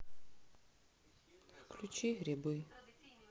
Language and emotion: Russian, sad